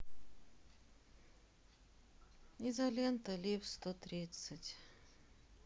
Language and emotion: Russian, sad